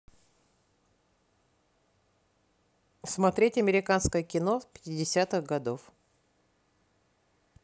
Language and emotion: Russian, neutral